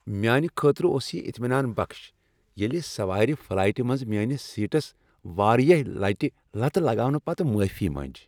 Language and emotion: Kashmiri, happy